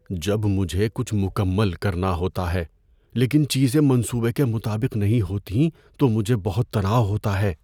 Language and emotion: Urdu, fearful